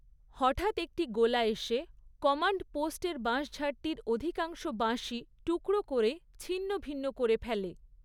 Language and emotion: Bengali, neutral